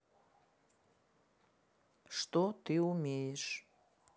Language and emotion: Russian, neutral